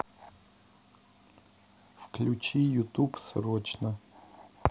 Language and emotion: Russian, neutral